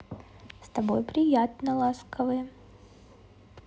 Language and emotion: Russian, positive